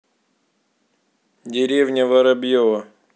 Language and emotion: Russian, neutral